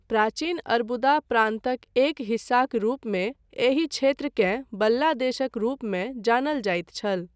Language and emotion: Maithili, neutral